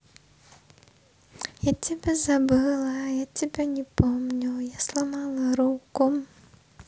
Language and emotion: Russian, positive